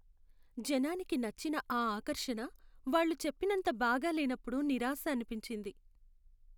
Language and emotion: Telugu, sad